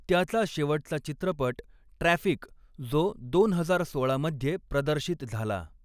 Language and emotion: Marathi, neutral